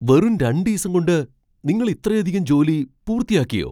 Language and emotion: Malayalam, surprised